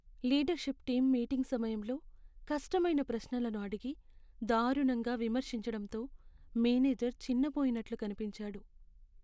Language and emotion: Telugu, sad